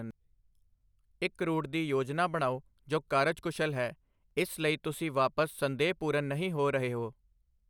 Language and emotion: Punjabi, neutral